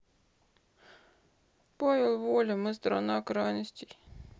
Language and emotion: Russian, sad